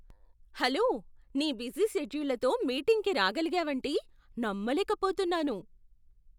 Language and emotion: Telugu, surprised